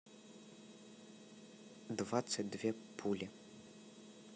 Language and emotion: Russian, neutral